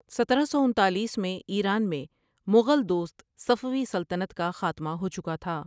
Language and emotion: Urdu, neutral